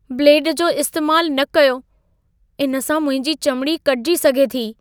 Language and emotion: Sindhi, fearful